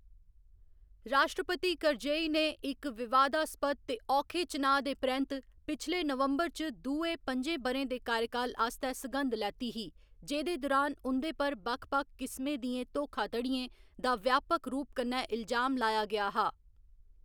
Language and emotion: Dogri, neutral